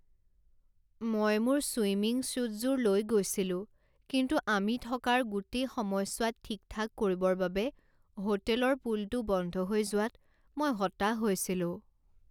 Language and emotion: Assamese, sad